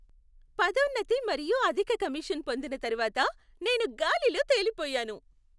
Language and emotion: Telugu, happy